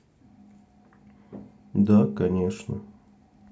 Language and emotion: Russian, sad